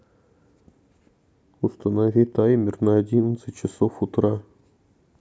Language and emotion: Russian, neutral